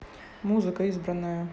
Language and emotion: Russian, neutral